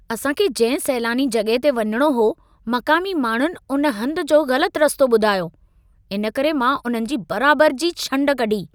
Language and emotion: Sindhi, angry